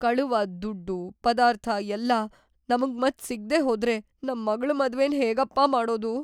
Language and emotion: Kannada, fearful